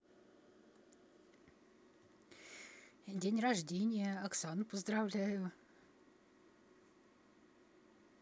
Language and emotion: Russian, neutral